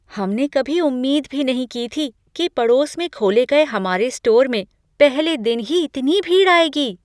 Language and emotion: Hindi, surprised